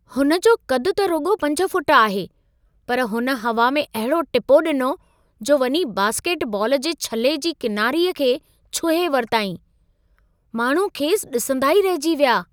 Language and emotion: Sindhi, surprised